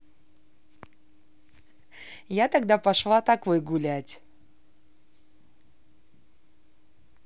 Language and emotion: Russian, positive